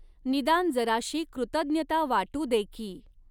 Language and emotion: Marathi, neutral